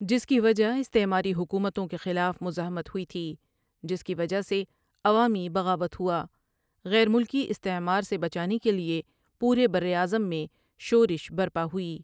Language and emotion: Urdu, neutral